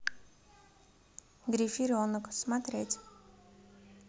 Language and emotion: Russian, neutral